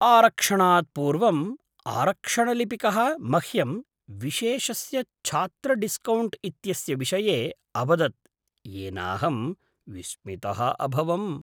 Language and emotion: Sanskrit, surprised